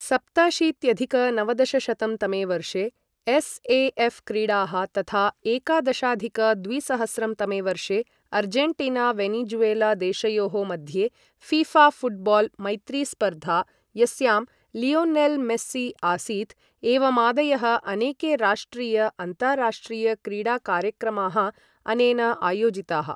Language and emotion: Sanskrit, neutral